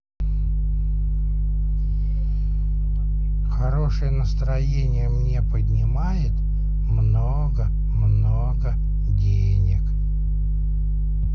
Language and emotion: Russian, positive